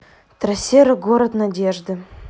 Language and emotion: Russian, neutral